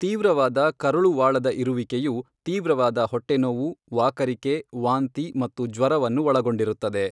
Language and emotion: Kannada, neutral